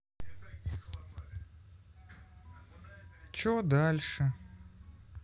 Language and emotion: Russian, sad